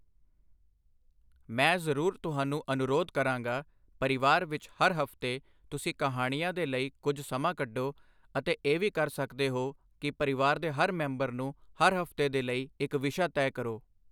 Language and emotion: Punjabi, neutral